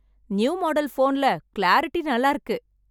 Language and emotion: Tamil, happy